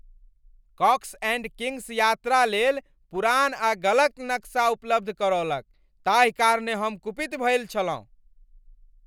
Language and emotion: Maithili, angry